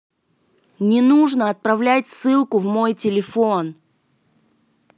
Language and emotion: Russian, angry